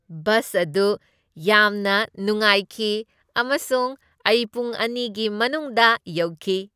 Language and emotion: Manipuri, happy